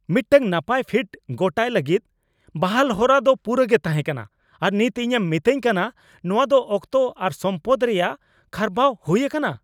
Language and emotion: Santali, angry